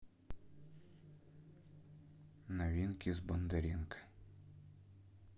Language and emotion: Russian, neutral